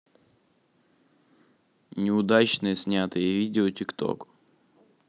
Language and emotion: Russian, neutral